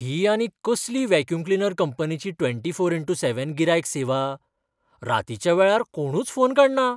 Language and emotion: Goan Konkani, surprised